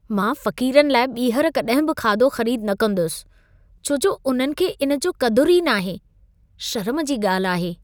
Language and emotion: Sindhi, disgusted